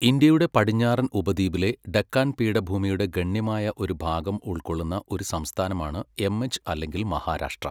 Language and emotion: Malayalam, neutral